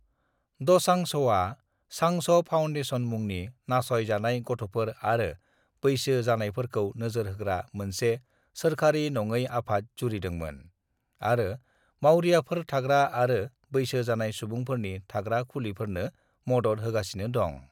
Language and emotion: Bodo, neutral